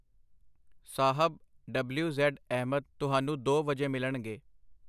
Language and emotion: Punjabi, neutral